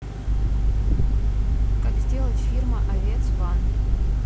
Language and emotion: Russian, neutral